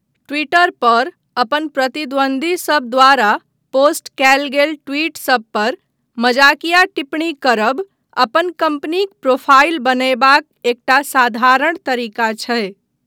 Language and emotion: Maithili, neutral